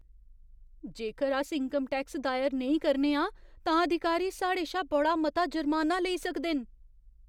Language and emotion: Dogri, fearful